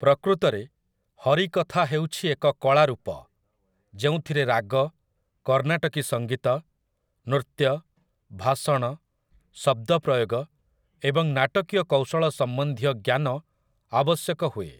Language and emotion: Odia, neutral